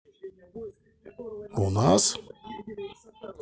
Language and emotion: Russian, neutral